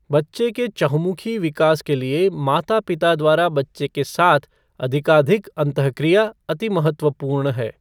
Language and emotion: Hindi, neutral